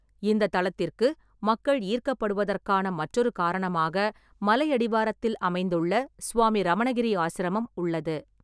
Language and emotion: Tamil, neutral